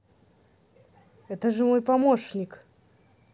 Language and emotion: Russian, neutral